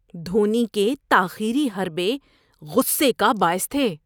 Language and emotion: Urdu, disgusted